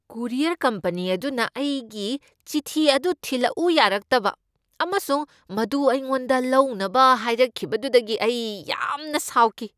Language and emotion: Manipuri, angry